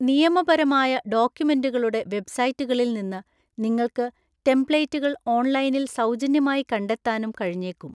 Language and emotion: Malayalam, neutral